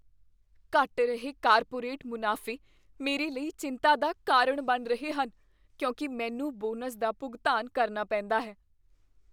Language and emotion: Punjabi, fearful